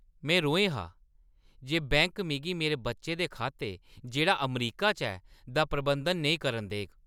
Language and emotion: Dogri, angry